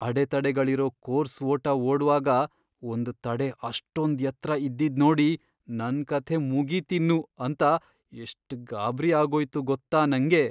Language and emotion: Kannada, fearful